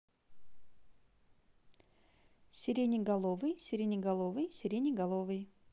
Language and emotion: Russian, neutral